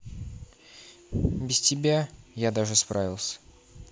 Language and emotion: Russian, neutral